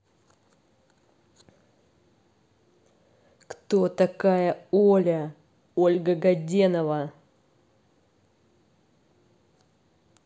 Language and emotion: Russian, angry